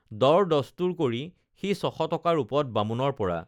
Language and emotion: Assamese, neutral